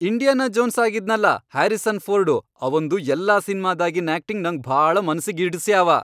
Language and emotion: Kannada, happy